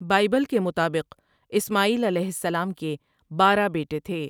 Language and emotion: Urdu, neutral